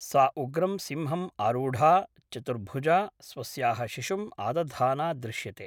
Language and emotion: Sanskrit, neutral